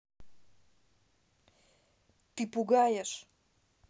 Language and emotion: Russian, neutral